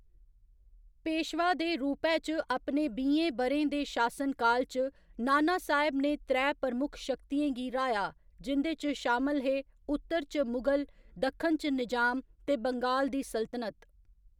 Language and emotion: Dogri, neutral